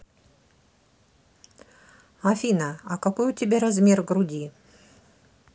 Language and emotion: Russian, neutral